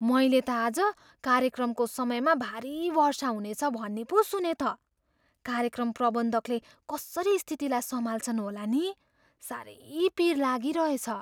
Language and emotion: Nepali, fearful